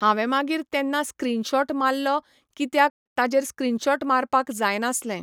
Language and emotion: Goan Konkani, neutral